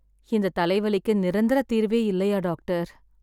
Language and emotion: Tamil, sad